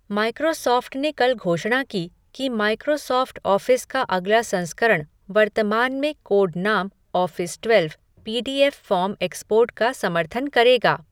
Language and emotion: Hindi, neutral